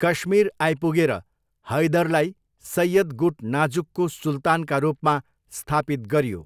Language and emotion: Nepali, neutral